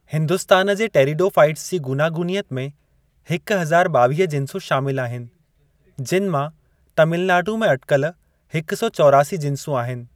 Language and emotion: Sindhi, neutral